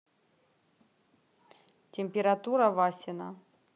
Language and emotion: Russian, neutral